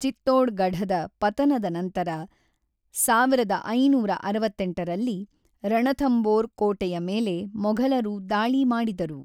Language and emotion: Kannada, neutral